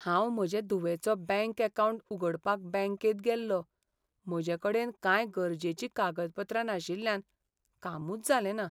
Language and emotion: Goan Konkani, sad